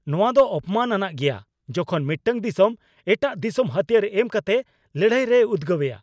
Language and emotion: Santali, angry